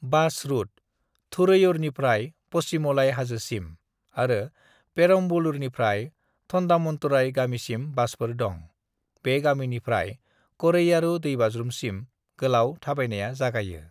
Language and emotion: Bodo, neutral